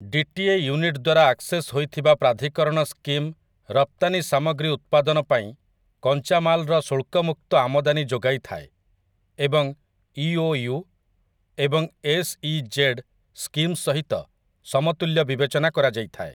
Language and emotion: Odia, neutral